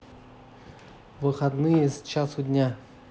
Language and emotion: Russian, neutral